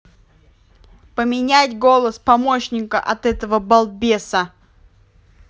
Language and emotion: Russian, angry